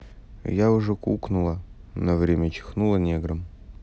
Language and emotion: Russian, neutral